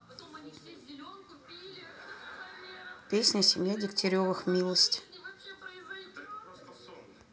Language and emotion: Russian, neutral